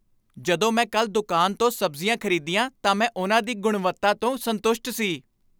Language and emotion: Punjabi, happy